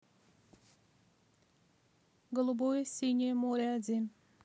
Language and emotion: Russian, neutral